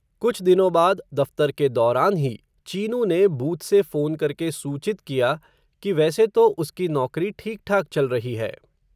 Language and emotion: Hindi, neutral